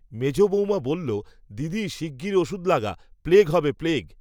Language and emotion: Bengali, neutral